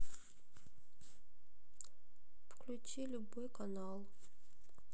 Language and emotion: Russian, sad